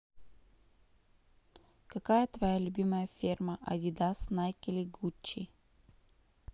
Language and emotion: Russian, neutral